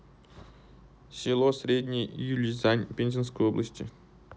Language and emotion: Russian, neutral